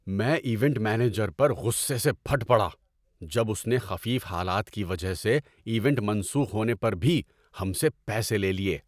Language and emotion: Urdu, angry